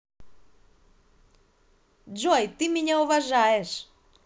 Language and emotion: Russian, positive